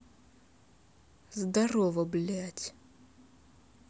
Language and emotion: Russian, angry